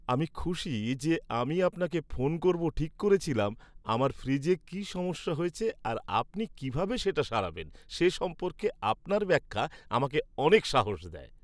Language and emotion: Bengali, happy